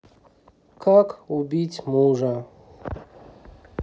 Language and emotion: Russian, sad